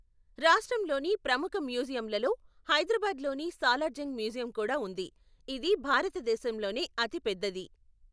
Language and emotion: Telugu, neutral